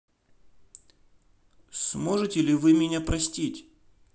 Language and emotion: Russian, sad